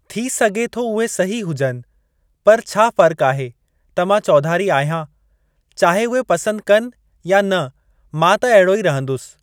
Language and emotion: Sindhi, neutral